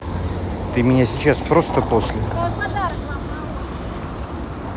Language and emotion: Russian, neutral